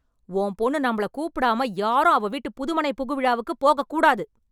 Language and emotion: Tamil, angry